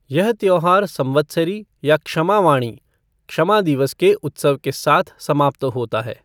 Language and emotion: Hindi, neutral